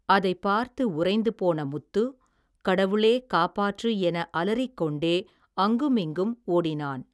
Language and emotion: Tamil, neutral